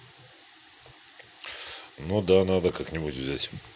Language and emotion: Russian, neutral